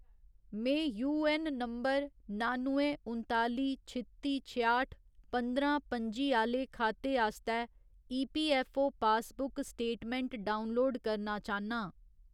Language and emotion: Dogri, neutral